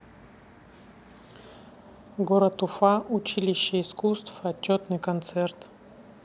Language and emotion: Russian, neutral